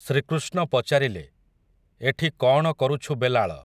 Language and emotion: Odia, neutral